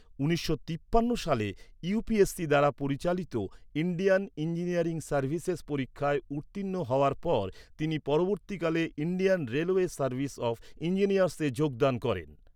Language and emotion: Bengali, neutral